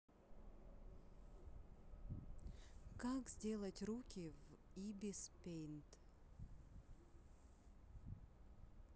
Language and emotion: Russian, neutral